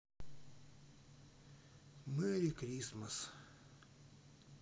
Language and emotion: Russian, sad